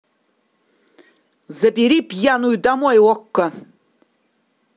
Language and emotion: Russian, angry